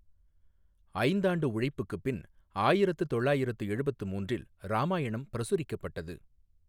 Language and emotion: Tamil, neutral